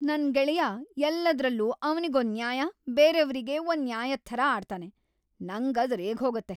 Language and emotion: Kannada, angry